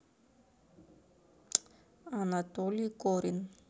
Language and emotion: Russian, neutral